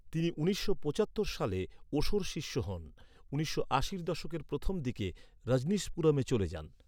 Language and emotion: Bengali, neutral